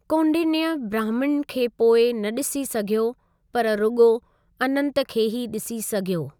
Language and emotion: Sindhi, neutral